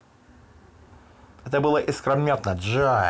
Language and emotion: Russian, positive